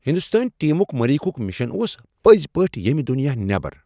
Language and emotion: Kashmiri, surprised